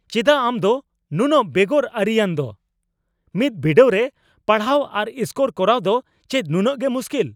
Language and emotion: Santali, angry